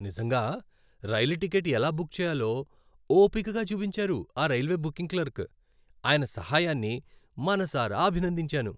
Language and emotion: Telugu, happy